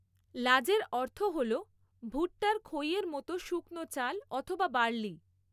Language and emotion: Bengali, neutral